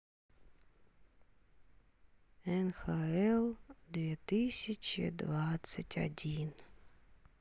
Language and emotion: Russian, sad